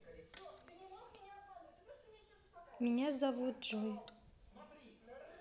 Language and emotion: Russian, neutral